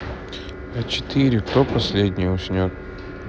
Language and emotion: Russian, neutral